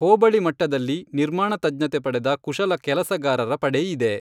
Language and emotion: Kannada, neutral